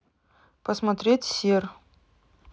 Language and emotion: Russian, neutral